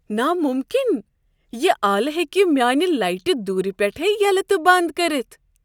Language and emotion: Kashmiri, surprised